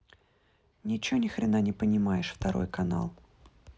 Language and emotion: Russian, angry